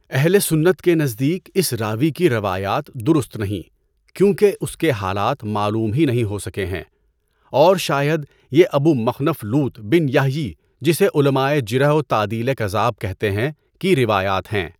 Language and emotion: Urdu, neutral